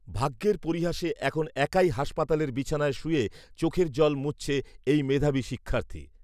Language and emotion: Bengali, neutral